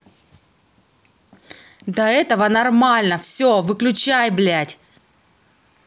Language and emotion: Russian, angry